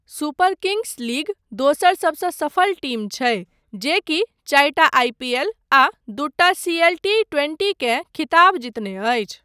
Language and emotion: Maithili, neutral